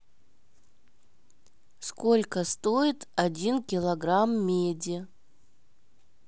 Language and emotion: Russian, neutral